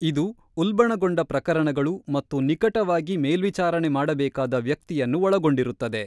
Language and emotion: Kannada, neutral